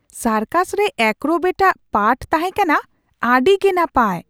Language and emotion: Santali, surprised